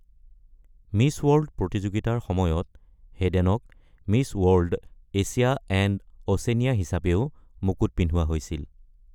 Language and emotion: Assamese, neutral